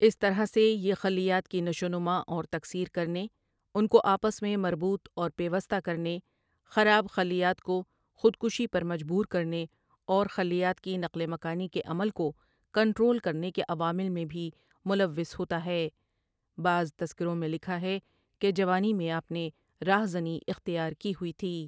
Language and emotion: Urdu, neutral